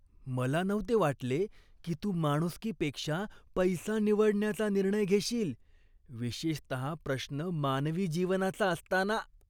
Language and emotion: Marathi, disgusted